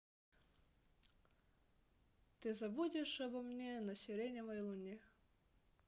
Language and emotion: Russian, sad